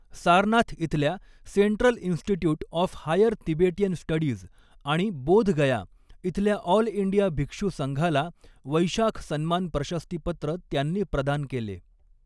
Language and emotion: Marathi, neutral